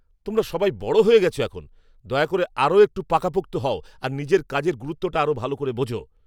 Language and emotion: Bengali, angry